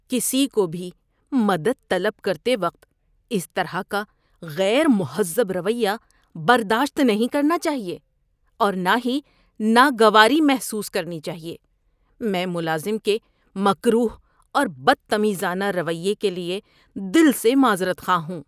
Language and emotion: Urdu, disgusted